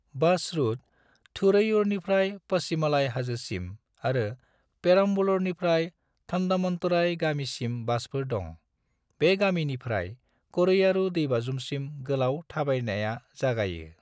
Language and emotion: Bodo, neutral